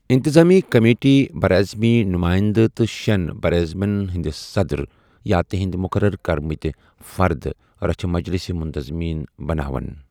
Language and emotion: Kashmiri, neutral